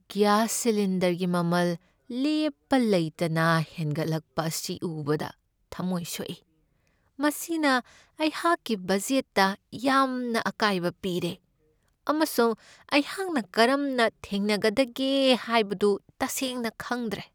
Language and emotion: Manipuri, sad